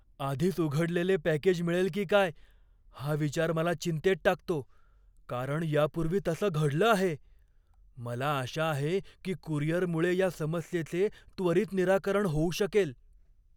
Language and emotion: Marathi, fearful